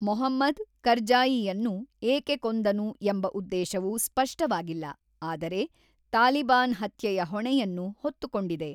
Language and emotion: Kannada, neutral